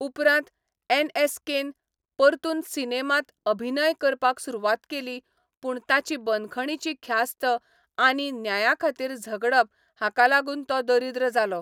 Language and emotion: Goan Konkani, neutral